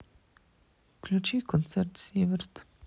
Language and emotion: Russian, sad